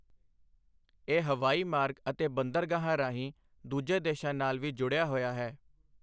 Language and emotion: Punjabi, neutral